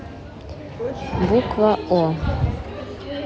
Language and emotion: Russian, neutral